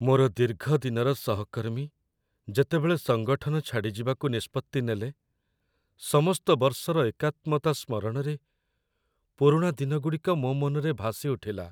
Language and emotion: Odia, sad